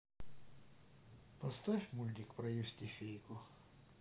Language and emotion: Russian, sad